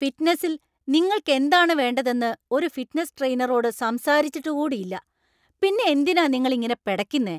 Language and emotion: Malayalam, angry